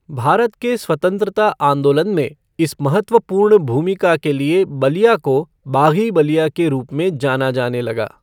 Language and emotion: Hindi, neutral